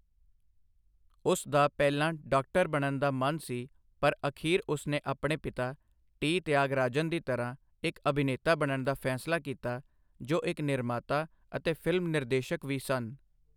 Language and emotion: Punjabi, neutral